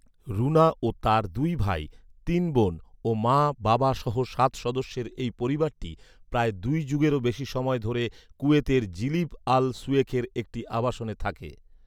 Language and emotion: Bengali, neutral